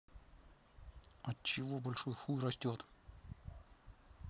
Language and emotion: Russian, neutral